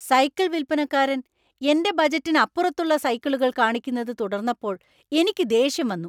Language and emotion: Malayalam, angry